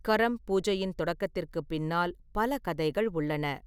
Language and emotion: Tamil, neutral